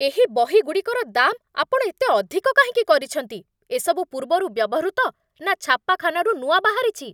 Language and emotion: Odia, angry